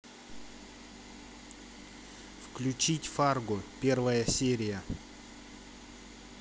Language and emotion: Russian, neutral